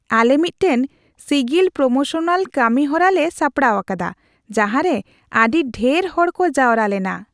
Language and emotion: Santali, happy